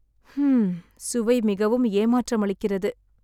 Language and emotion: Tamil, sad